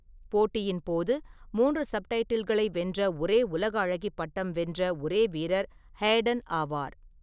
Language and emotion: Tamil, neutral